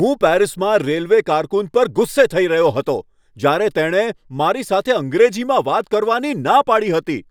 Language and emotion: Gujarati, angry